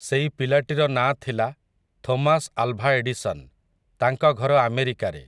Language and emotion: Odia, neutral